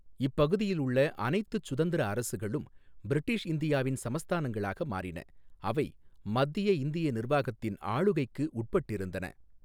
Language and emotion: Tamil, neutral